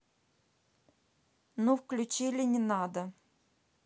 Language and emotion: Russian, neutral